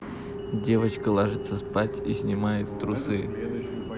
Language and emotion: Russian, neutral